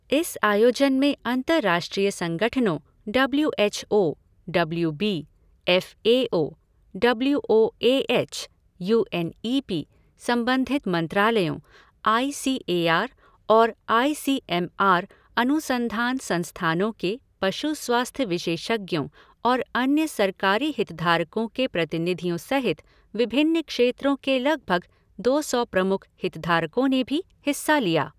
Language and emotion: Hindi, neutral